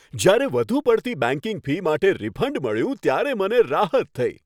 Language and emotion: Gujarati, happy